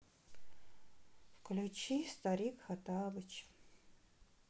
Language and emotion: Russian, sad